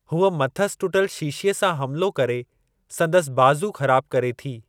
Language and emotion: Sindhi, neutral